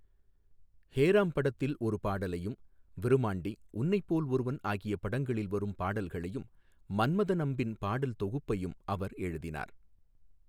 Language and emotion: Tamil, neutral